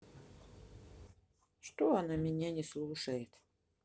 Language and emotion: Russian, sad